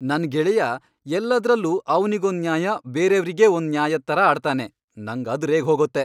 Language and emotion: Kannada, angry